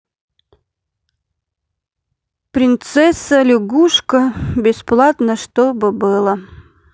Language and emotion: Russian, sad